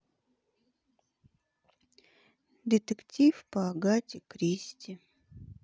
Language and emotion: Russian, sad